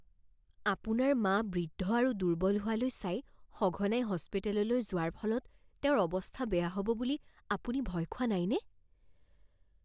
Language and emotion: Assamese, fearful